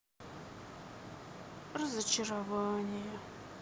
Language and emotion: Russian, sad